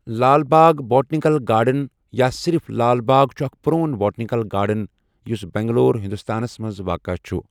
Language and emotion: Kashmiri, neutral